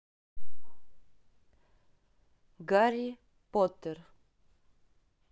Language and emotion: Russian, neutral